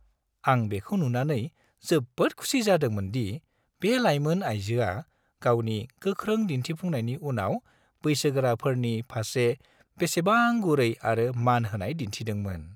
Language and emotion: Bodo, happy